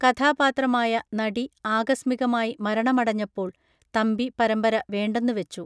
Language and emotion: Malayalam, neutral